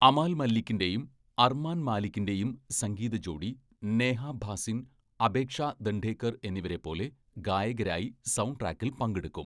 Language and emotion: Malayalam, neutral